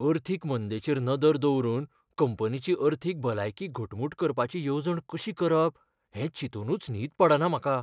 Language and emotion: Goan Konkani, fearful